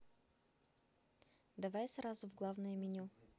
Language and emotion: Russian, neutral